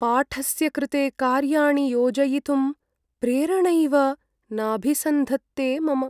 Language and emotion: Sanskrit, sad